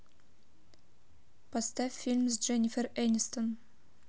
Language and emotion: Russian, neutral